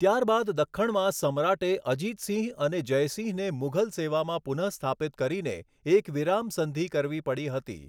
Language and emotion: Gujarati, neutral